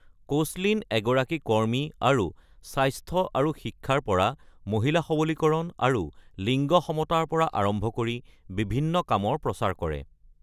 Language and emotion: Assamese, neutral